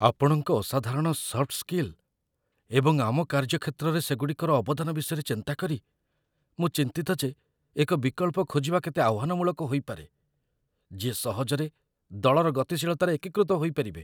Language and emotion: Odia, fearful